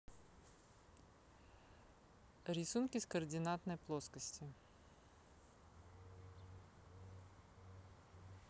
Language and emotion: Russian, neutral